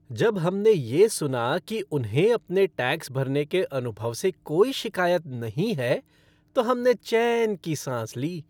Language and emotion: Hindi, happy